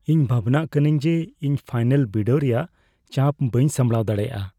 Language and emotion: Santali, fearful